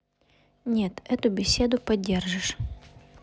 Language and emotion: Russian, neutral